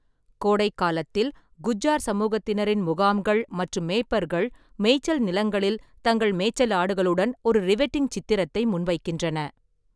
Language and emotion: Tamil, neutral